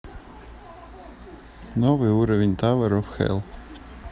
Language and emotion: Russian, neutral